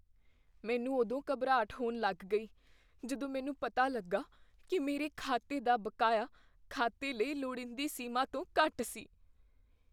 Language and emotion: Punjabi, fearful